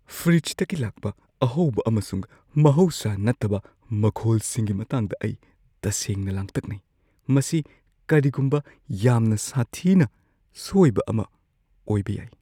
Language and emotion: Manipuri, fearful